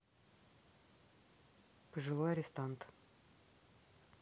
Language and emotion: Russian, neutral